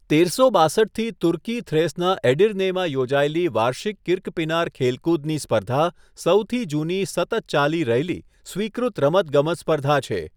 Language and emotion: Gujarati, neutral